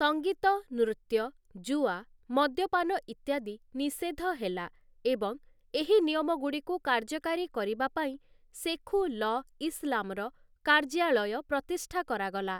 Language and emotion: Odia, neutral